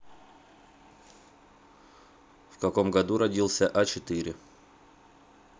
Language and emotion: Russian, neutral